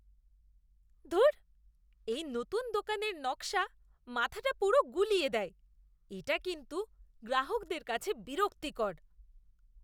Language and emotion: Bengali, disgusted